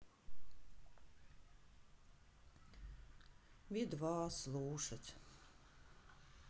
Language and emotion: Russian, sad